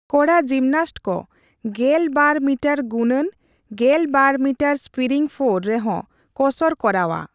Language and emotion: Santali, neutral